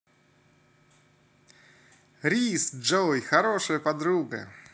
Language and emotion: Russian, positive